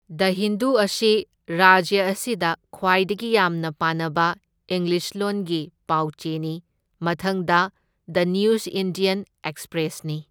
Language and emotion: Manipuri, neutral